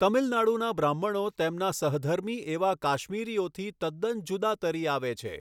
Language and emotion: Gujarati, neutral